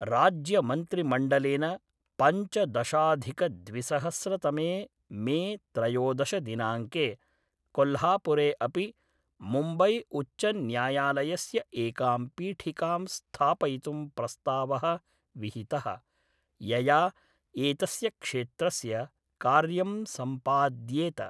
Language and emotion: Sanskrit, neutral